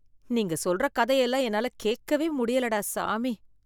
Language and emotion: Tamil, disgusted